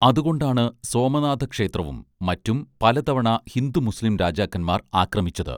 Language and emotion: Malayalam, neutral